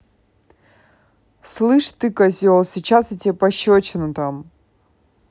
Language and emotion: Russian, angry